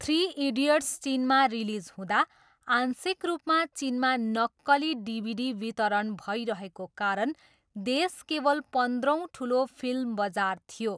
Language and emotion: Nepali, neutral